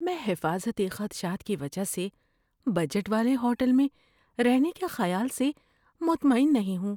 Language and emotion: Urdu, fearful